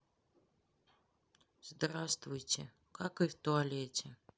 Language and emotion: Russian, sad